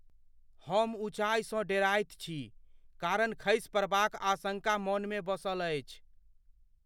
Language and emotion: Maithili, fearful